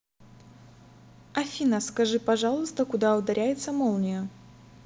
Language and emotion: Russian, neutral